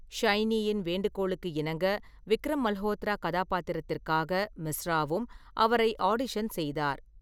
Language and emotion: Tamil, neutral